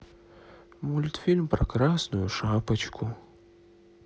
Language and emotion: Russian, sad